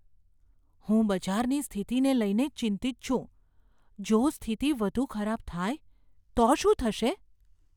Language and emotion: Gujarati, fearful